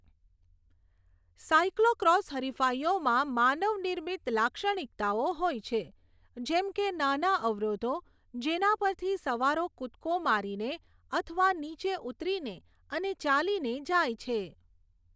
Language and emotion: Gujarati, neutral